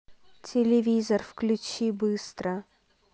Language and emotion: Russian, angry